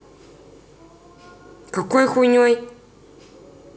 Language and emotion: Russian, angry